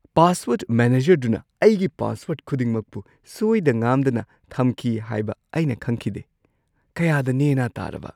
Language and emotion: Manipuri, surprised